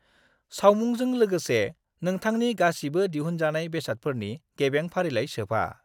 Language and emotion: Bodo, neutral